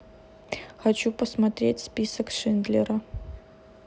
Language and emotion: Russian, neutral